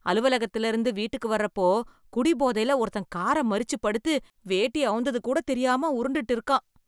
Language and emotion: Tamil, disgusted